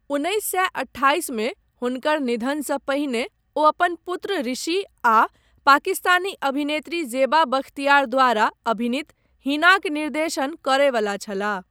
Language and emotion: Maithili, neutral